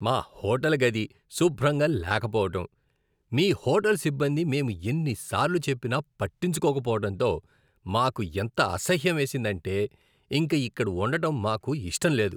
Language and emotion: Telugu, disgusted